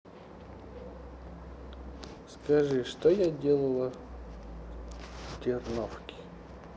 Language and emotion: Russian, neutral